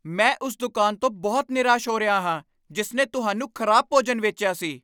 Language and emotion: Punjabi, angry